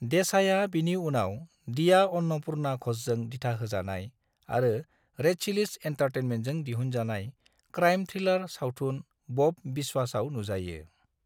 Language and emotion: Bodo, neutral